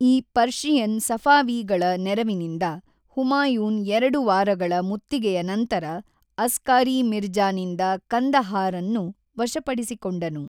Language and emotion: Kannada, neutral